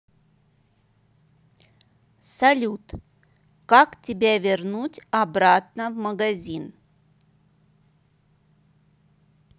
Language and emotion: Russian, neutral